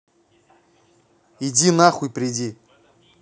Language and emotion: Russian, angry